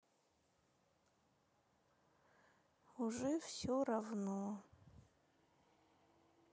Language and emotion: Russian, sad